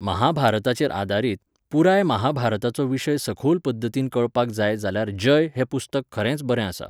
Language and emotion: Goan Konkani, neutral